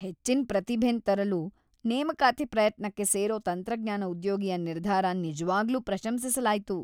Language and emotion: Kannada, happy